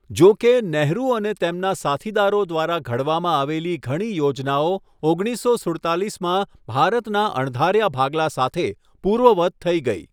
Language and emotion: Gujarati, neutral